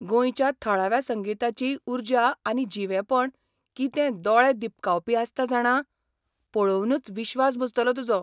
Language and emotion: Goan Konkani, surprised